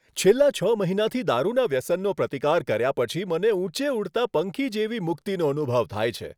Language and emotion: Gujarati, happy